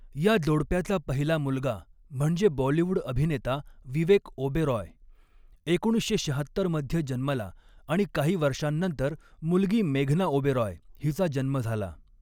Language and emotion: Marathi, neutral